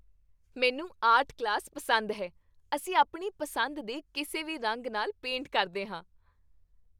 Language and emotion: Punjabi, happy